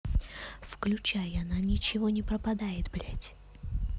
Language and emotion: Russian, neutral